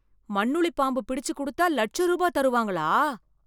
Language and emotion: Tamil, surprised